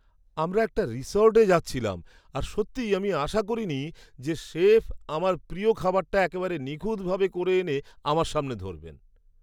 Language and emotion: Bengali, surprised